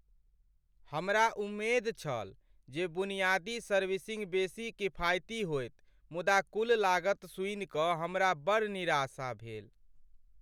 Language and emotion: Maithili, sad